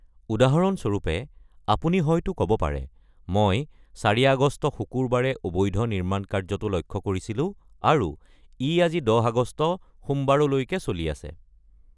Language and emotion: Assamese, neutral